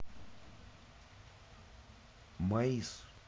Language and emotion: Russian, neutral